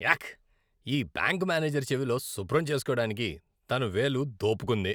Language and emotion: Telugu, disgusted